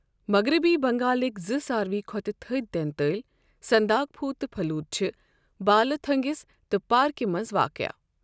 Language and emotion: Kashmiri, neutral